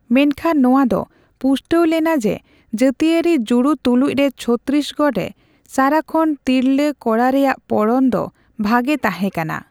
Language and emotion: Santali, neutral